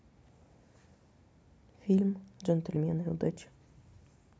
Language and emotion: Russian, neutral